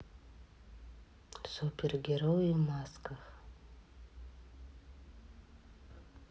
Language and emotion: Russian, neutral